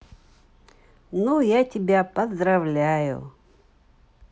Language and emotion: Russian, positive